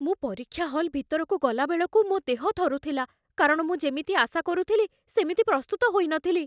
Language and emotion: Odia, fearful